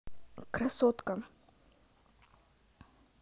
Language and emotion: Russian, neutral